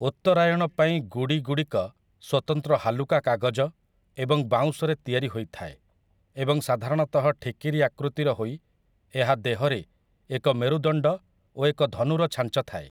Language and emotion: Odia, neutral